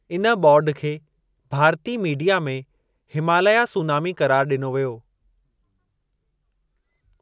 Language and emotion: Sindhi, neutral